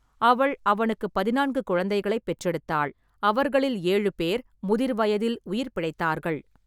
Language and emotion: Tamil, neutral